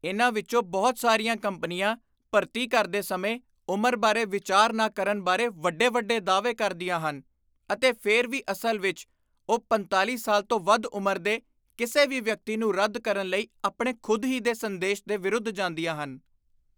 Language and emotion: Punjabi, disgusted